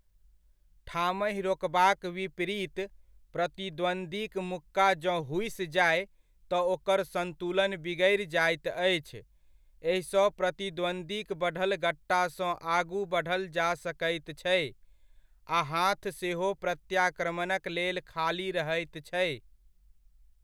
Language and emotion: Maithili, neutral